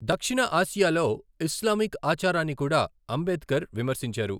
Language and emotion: Telugu, neutral